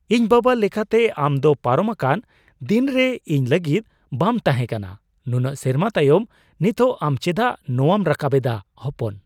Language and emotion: Santali, surprised